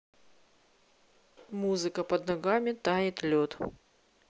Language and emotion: Russian, neutral